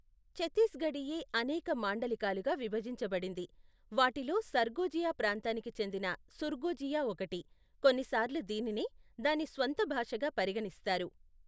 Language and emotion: Telugu, neutral